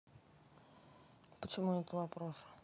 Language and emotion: Russian, neutral